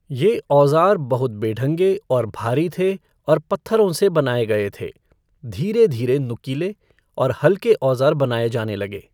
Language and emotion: Hindi, neutral